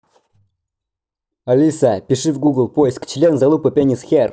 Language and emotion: Russian, angry